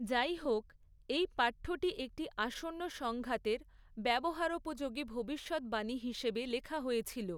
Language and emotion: Bengali, neutral